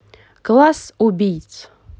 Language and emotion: Russian, positive